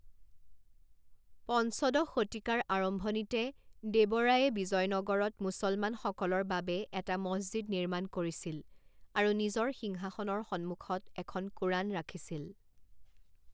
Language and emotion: Assamese, neutral